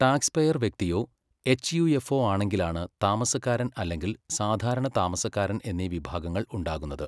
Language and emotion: Malayalam, neutral